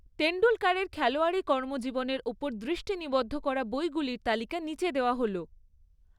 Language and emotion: Bengali, neutral